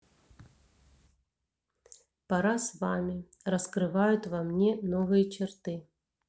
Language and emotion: Russian, neutral